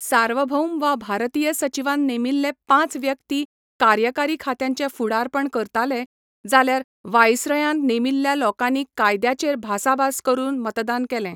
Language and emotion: Goan Konkani, neutral